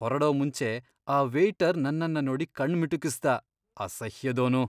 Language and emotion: Kannada, disgusted